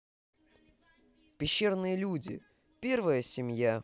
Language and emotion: Russian, positive